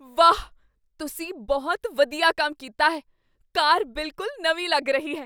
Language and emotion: Punjabi, surprised